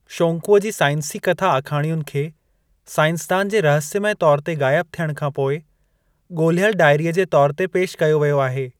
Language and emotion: Sindhi, neutral